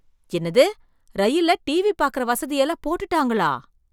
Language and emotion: Tamil, surprised